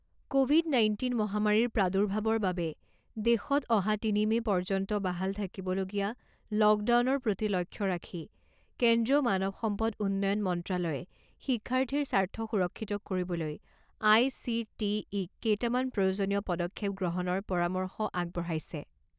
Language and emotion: Assamese, neutral